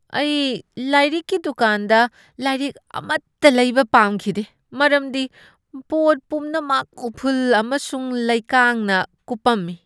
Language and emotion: Manipuri, disgusted